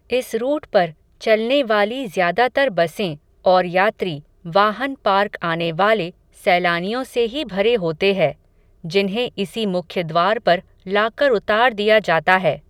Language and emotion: Hindi, neutral